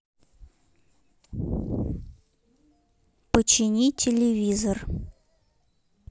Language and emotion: Russian, neutral